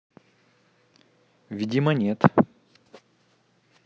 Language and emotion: Russian, neutral